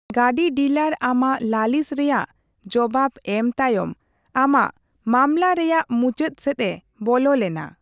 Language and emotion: Santali, neutral